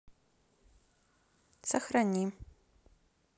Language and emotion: Russian, neutral